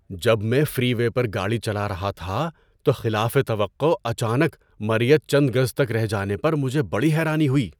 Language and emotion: Urdu, surprised